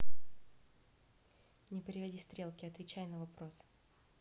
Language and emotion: Russian, neutral